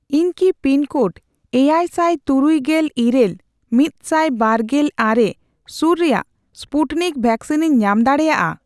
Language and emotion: Santali, neutral